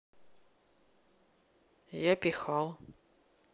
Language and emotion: Russian, neutral